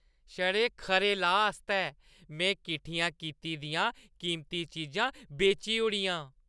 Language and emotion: Dogri, happy